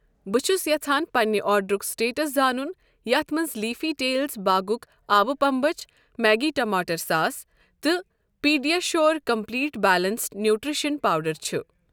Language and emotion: Kashmiri, neutral